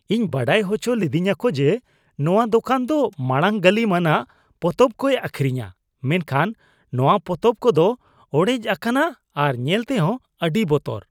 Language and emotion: Santali, disgusted